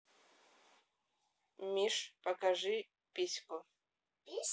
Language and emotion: Russian, neutral